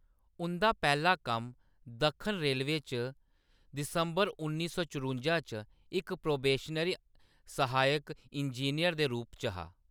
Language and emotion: Dogri, neutral